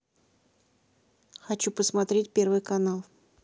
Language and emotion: Russian, neutral